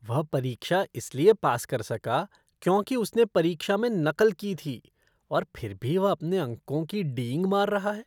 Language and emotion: Hindi, disgusted